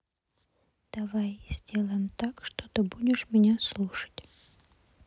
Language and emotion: Russian, neutral